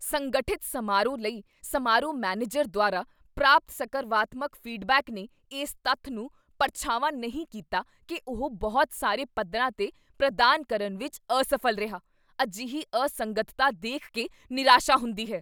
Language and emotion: Punjabi, angry